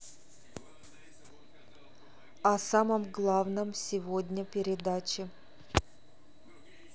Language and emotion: Russian, neutral